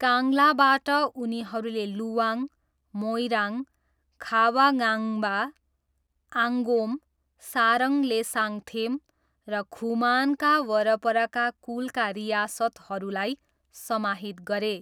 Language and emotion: Nepali, neutral